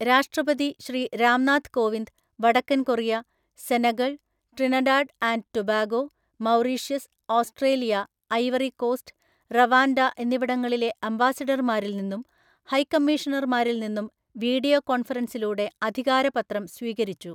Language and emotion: Malayalam, neutral